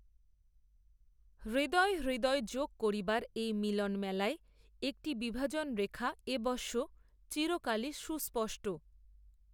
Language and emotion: Bengali, neutral